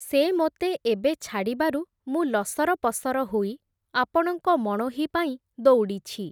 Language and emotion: Odia, neutral